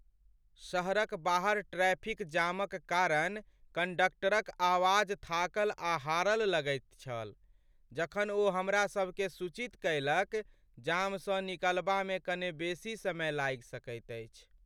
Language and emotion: Maithili, sad